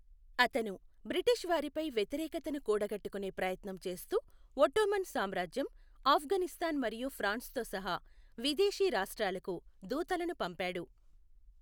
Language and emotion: Telugu, neutral